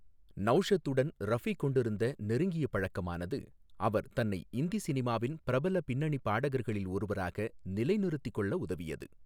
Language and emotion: Tamil, neutral